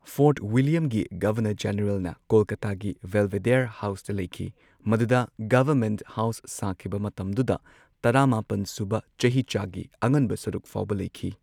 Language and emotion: Manipuri, neutral